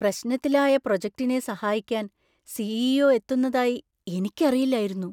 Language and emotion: Malayalam, surprised